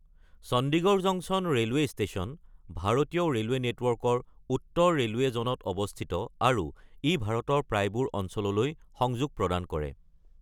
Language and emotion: Assamese, neutral